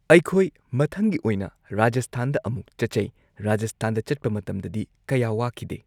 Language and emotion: Manipuri, neutral